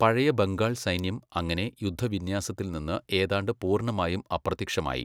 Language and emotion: Malayalam, neutral